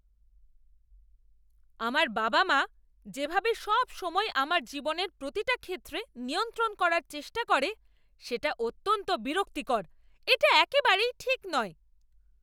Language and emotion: Bengali, angry